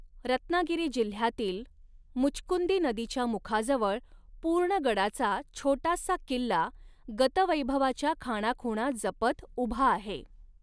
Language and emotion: Marathi, neutral